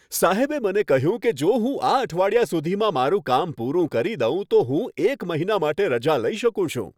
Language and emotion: Gujarati, happy